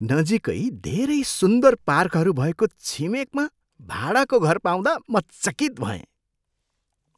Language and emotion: Nepali, surprised